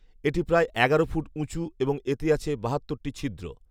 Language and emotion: Bengali, neutral